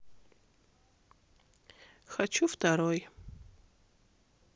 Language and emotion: Russian, sad